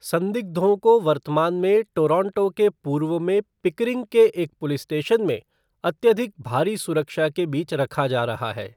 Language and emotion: Hindi, neutral